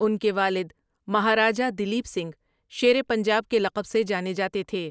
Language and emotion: Urdu, neutral